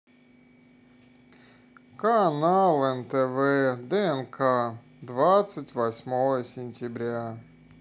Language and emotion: Russian, sad